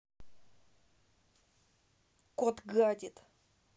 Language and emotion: Russian, angry